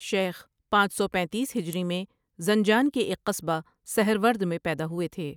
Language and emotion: Urdu, neutral